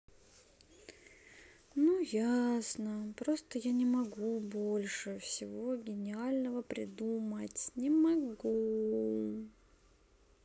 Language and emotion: Russian, sad